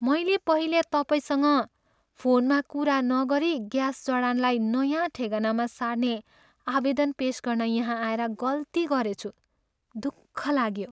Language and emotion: Nepali, sad